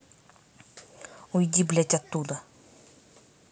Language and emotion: Russian, angry